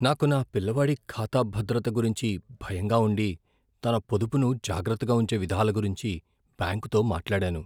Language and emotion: Telugu, fearful